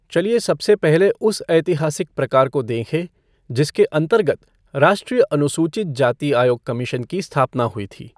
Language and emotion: Hindi, neutral